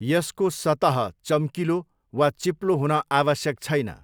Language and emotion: Nepali, neutral